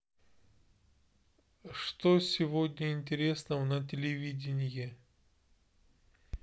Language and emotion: Russian, neutral